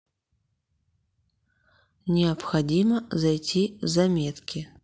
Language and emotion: Russian, neutral